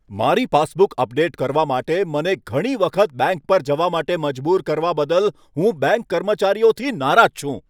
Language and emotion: Gujarati, angry